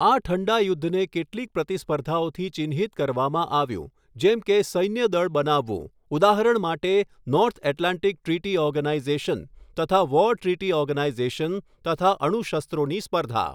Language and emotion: Gujarati, neutral